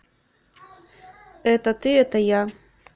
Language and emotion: Russian, neutral